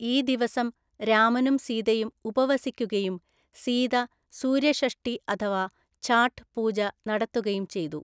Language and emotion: Malayalam, neutral